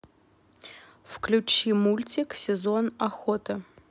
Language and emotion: Russian, neutral